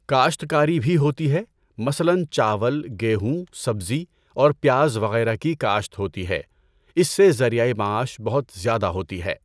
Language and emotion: Urdu, neutral